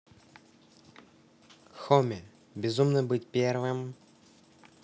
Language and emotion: Russian, neutral